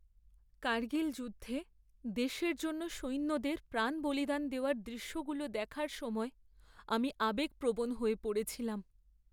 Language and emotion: Bengali, sad